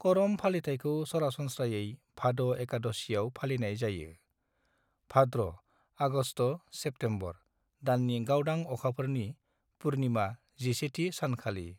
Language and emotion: Bodo, neutral